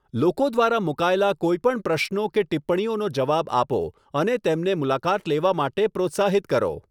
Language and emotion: Gujarati, neutral